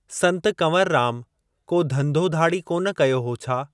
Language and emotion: Sindhi, neutral